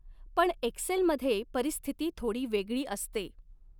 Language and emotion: Marathi, neutral